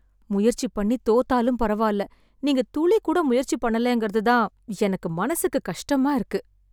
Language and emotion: Tamil, sad